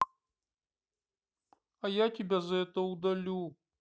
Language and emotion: Russian, sad